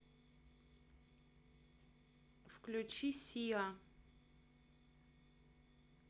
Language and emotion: Russian, neutral